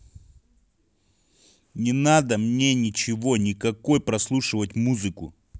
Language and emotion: Russian, angry